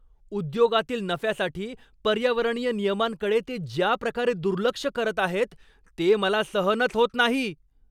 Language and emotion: Marathi, angry